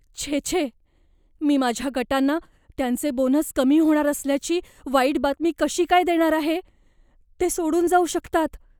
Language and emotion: Marathi, fearful